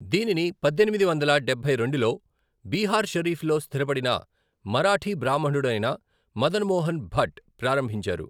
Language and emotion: Telugu, neutral